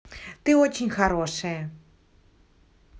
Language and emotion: Russian, positive